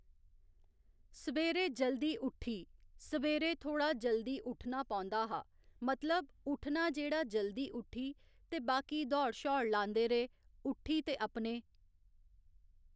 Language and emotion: Dogri, neutral